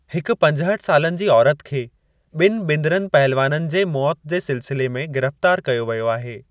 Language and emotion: Sindhi, neutral